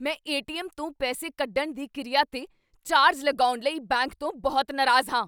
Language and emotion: Punjabi, angry